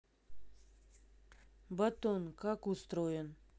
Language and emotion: Russian, neutral